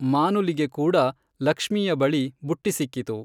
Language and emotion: Kannada, neutral